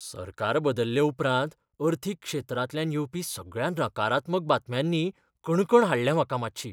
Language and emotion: Goan Konkani, fearful